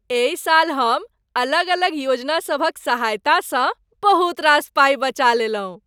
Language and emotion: Maithili, happy